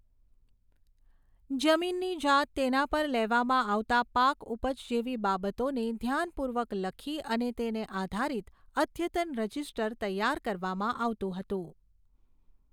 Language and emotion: Gujarati, neutral